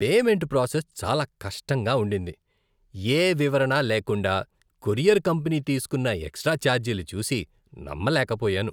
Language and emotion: Telugu, disgusted